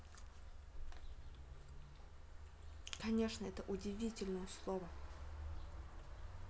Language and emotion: Russian, neutral